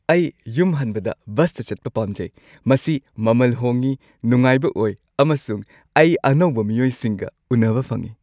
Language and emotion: Manipuri, happy